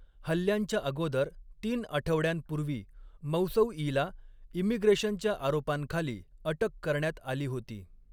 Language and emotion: Marathi, neutral